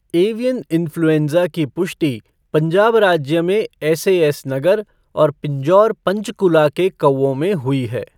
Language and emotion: Hindi, neutral